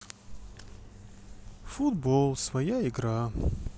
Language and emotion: Russian, sad